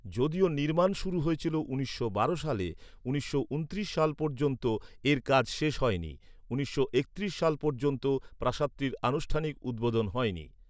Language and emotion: Bengali, neutral